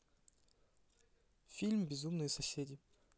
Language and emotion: Russian, neutral